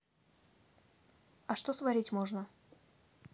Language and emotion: Russian, neutral